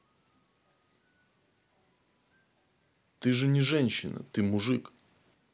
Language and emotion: Russian, neutral